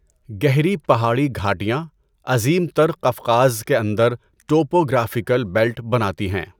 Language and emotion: Urdu, neutral